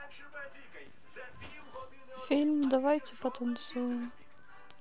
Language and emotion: Russian, sad